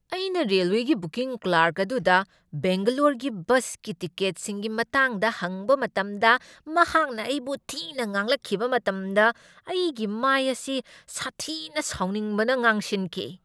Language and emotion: Manipuri, angry